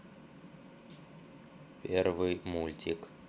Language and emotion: Russian, neutral